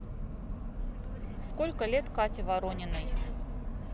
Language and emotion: Russian, neutral